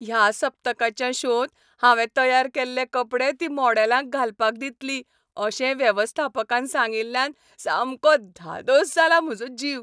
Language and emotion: Goan Konkani, happy